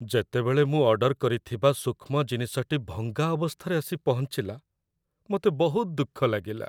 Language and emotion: Odia, sad